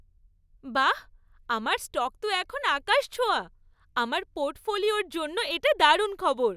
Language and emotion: Bengali, happy